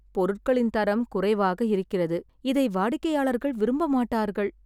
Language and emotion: Tamil, sad